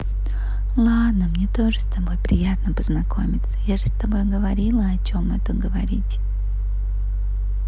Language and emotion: Russian, positive